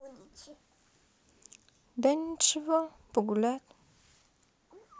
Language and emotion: Russian, sad